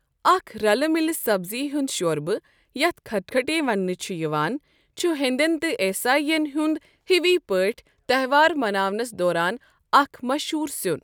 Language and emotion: Kashmiri, neutral